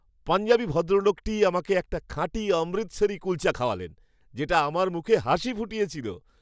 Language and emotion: Bengali, happy